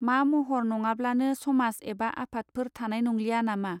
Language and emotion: Bodo, neutral